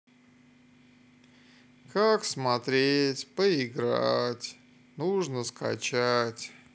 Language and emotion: Russian, sad